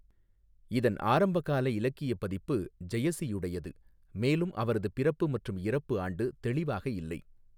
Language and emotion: Tamil, neutral